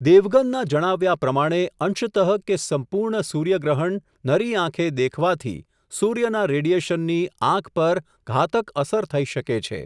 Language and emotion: Gujarati, neutral